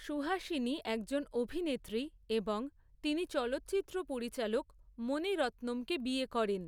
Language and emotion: Bengali, neutral